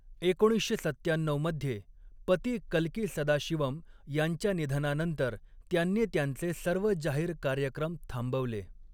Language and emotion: Marathi, neutral